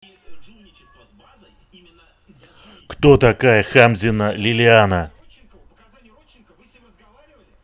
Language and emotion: Russian, angry